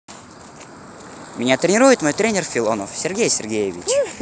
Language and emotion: Russian, positive